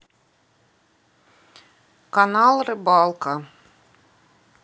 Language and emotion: Russian, neutral